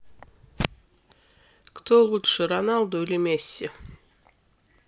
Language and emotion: Russian, neutral